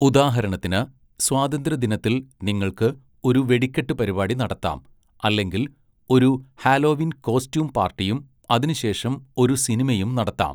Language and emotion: Malayalam, neutral